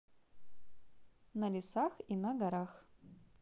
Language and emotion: Russian, positive